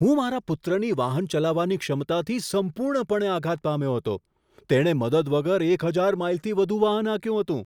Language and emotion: Gujarati, surprised